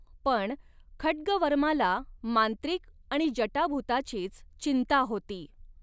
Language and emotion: Marathi, neutral